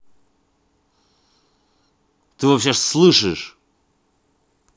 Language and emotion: Russian, angry